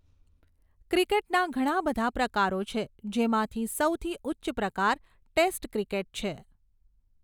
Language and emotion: Gujarati, neutral